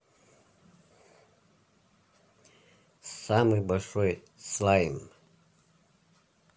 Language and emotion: Russian, neutral